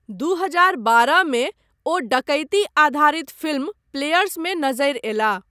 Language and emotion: Maithili, neutral